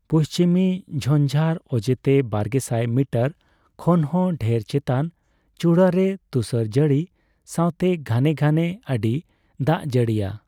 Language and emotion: Santali, neutral